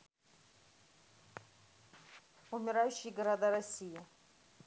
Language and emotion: Russian, neutral